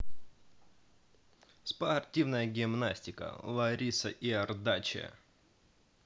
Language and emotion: Russian, positive